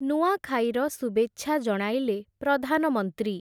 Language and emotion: Odia, neutral